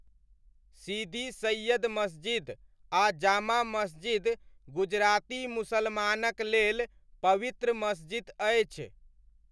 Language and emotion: Maithili, neutral